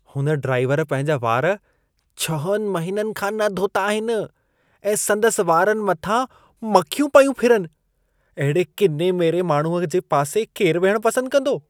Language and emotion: Sindhi, disgusted